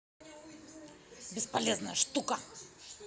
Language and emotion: Russian, angry